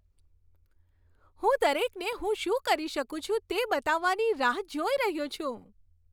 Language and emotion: Gujarati, happy